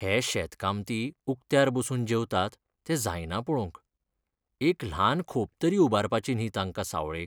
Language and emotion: Goan Konkani, sad